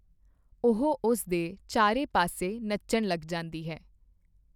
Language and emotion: Punjabi, neutral